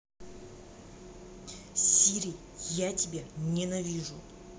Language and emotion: Russian, angry